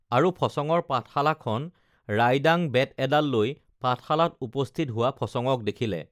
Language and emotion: Assamese, neutral